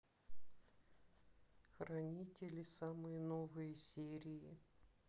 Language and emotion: Russian, neutral